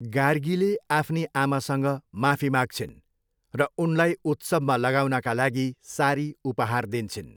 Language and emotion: Nepali, neutral